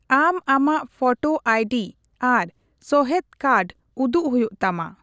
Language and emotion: Santali, neutral